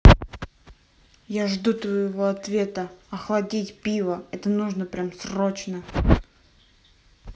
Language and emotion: Russian, angry